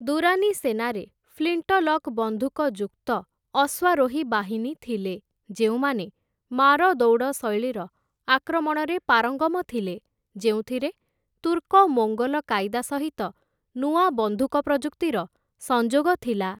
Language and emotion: Odia, neutral